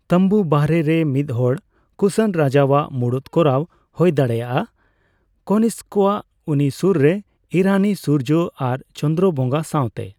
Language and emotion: Santali, neutral